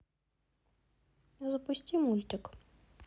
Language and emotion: Russian, neutral